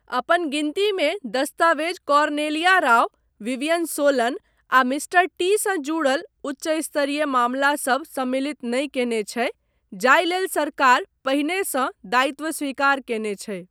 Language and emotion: Maithili, neutral